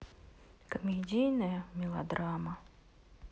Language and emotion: Russian, sad